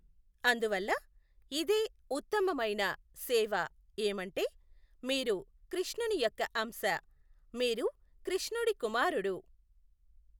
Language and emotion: Telugu, neutral